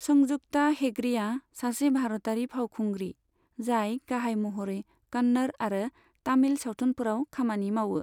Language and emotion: Bodo, neutral